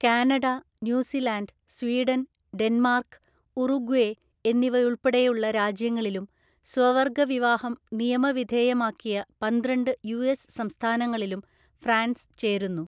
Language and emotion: Malayalam, neutral